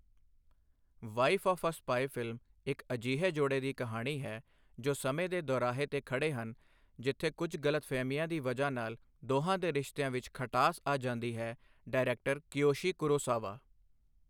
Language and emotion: Punjabi, neutral